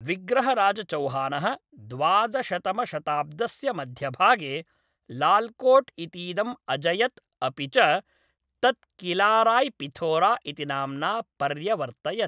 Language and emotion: Sanskrit, neutral